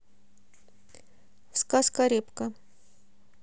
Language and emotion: Russian, neutral